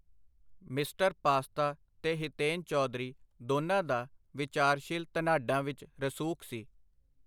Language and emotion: Punjabi, neutral